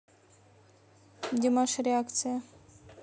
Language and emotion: Russian, neutral